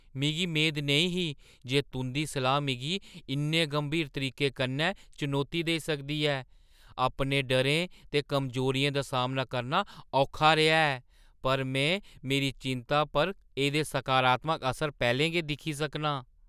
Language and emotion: Dogri, surprised